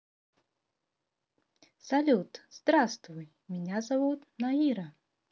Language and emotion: Russian, positive